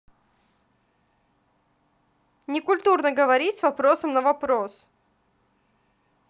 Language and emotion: Russian, angry